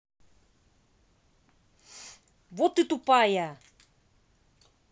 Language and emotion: Russian, angry